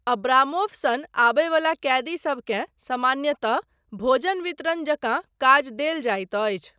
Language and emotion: Maithili, neutral